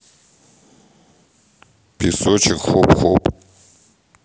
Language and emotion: Russian, neutral